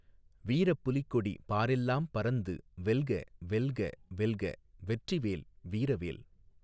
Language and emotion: Tamil, neutral